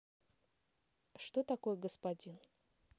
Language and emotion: Russian, neutral